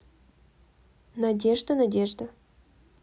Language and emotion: Russian, neutral